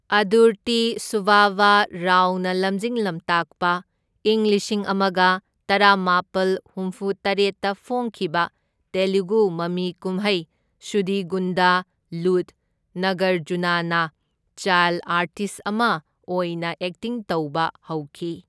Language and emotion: Manipuri, neutral